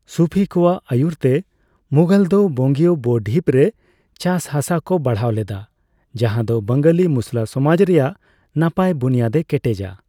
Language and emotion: Santali, neutral